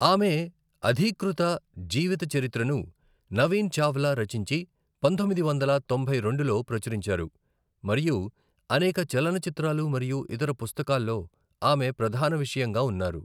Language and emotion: Telugu, neutral